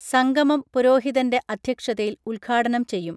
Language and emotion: Malayalam, neutral